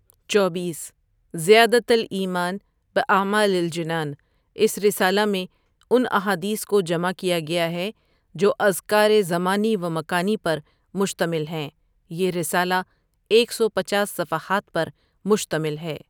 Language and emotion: Urdu, neutral